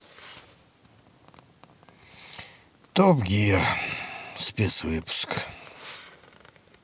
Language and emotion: Russian, sad